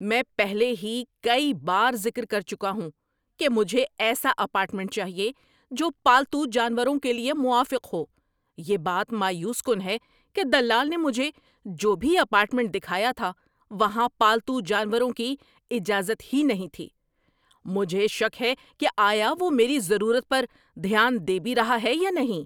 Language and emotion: Urdu, angry